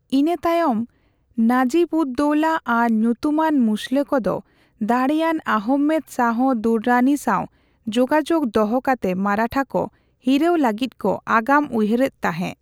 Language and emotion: Santali, neutral